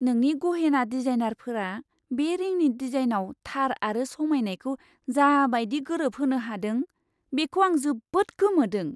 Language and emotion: Bodo, surprised